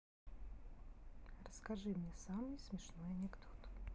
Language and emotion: Russian, neutral